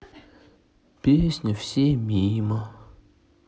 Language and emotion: Russian, sad